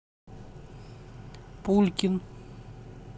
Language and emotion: Russian, neutral